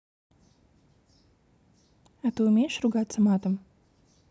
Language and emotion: Russian, neutral